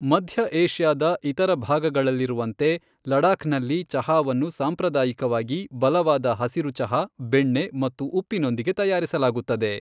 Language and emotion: Kannada, neutral